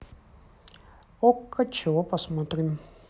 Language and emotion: Russian, neutral